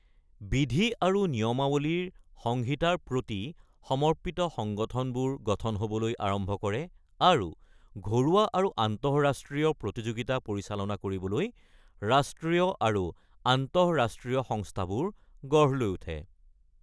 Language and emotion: Assamese, neutral